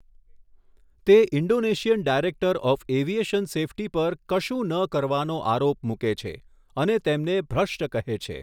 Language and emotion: Gujarati, neutral